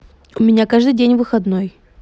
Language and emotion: Russian, neutral